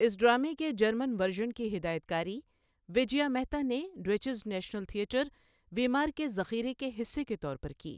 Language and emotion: Urdu, neutral